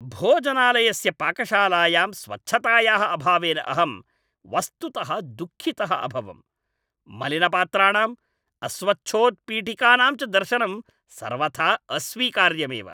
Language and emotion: Sanskrit, angry